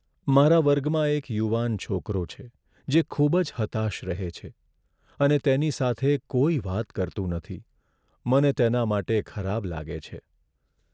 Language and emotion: Gujarati, sad